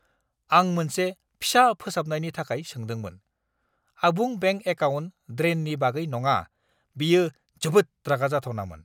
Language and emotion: Bodo, angry